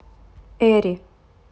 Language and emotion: Russian, neutral